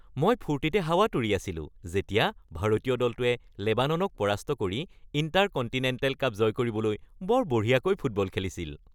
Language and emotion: Assamese, happy